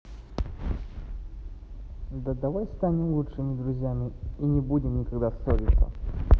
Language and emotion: Russian, neutral